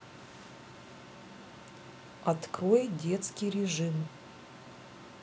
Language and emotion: Russian, neutral